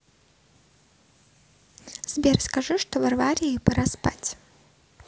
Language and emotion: Russian, neutral